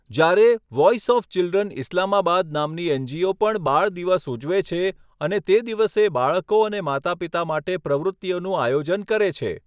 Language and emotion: Gujarati, neutral